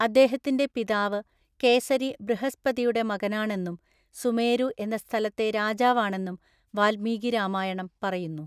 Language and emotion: Malayalam, neutral